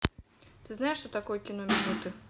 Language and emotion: Russian, neutral